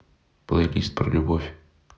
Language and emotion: Russian, neutral